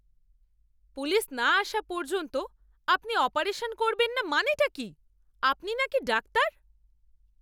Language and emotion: Bengali, angry